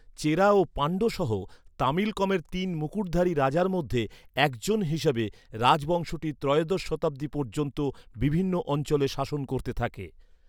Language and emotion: Bengali, neutral